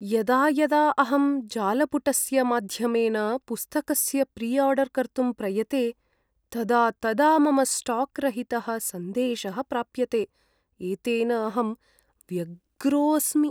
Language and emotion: Sanskrit, sad